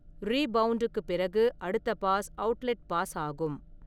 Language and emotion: Tamil, neutral